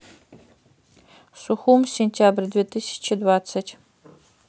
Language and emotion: Russian, neutral